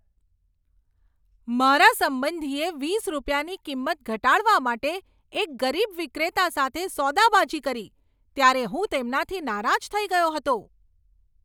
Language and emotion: Gujarati, angry